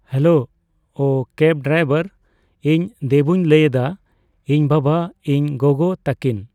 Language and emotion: Santali, neutral